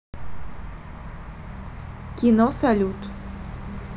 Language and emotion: Russian, neutral